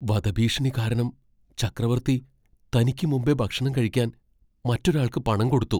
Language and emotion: Malayalam, fearful